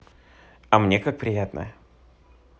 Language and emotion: Russian, positive